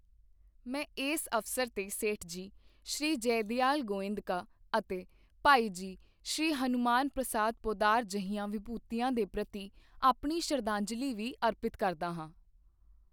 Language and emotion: Punjabi, neutral